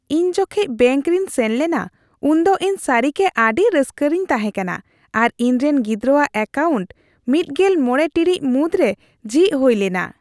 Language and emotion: Santali, happy